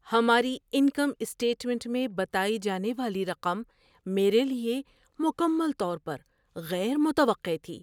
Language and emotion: Urdu, surprised